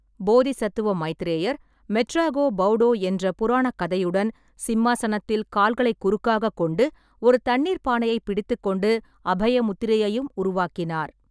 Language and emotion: Tamil, neutral